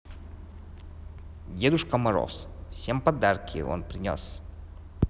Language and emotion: Russian, neutral